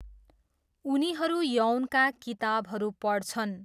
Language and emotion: Nepali, neutral